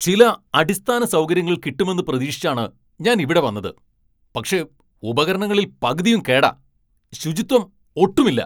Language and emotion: Malayalam, angry